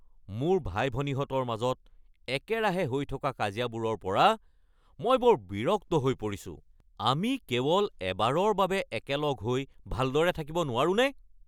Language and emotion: Assamese, angry